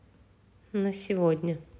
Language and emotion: Russian, neutral